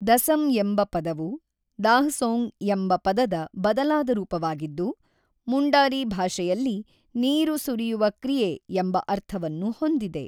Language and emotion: Kannada, neutral